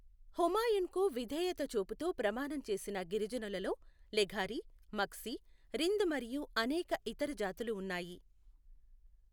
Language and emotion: Telugu, neutral